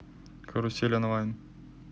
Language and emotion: Russian, neutral